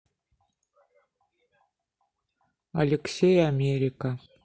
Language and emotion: Russian, neutral